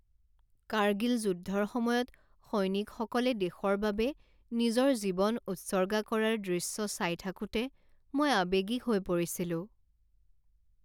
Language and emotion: Assamese, sad